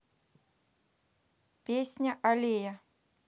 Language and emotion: Russian, neutral